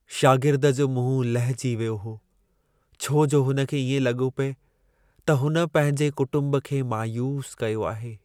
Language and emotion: Sindhi, sad